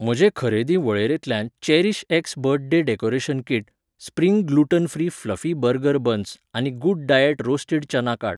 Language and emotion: Goan Konkani, neutral